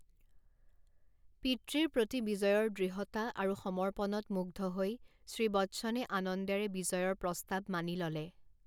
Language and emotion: Assamese, neutral